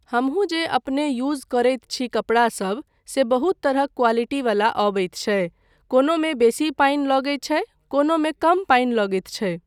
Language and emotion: Maithili, neutral